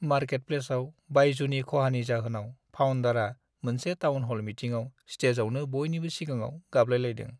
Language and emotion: Bodo, sad